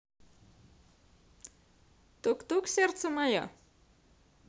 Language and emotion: Russian, positive